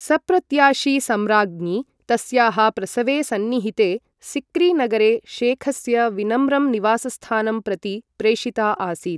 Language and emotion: Sanskrit, neutral